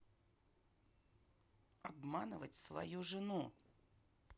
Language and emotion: Russian, neutral